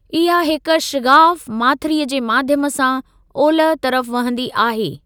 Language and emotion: Sindhi, neutral